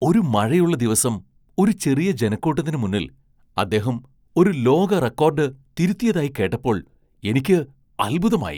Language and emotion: Malayalam, surprised